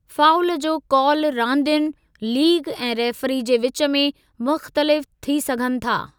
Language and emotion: Sindhi, neutral